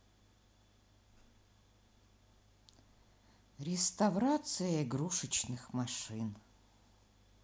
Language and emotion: Russian, sad